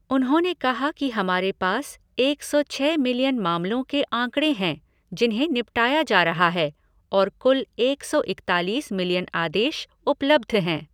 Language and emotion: Hindi, neutral